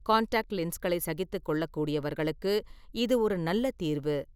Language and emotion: Tamil, neutral